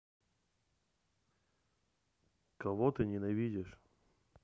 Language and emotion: Russian, neutral